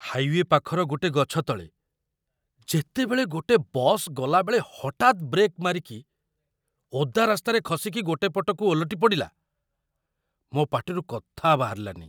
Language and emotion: Odia, surprised